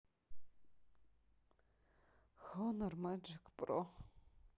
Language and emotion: Russian, sad